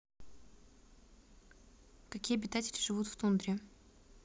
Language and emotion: Russian, neutral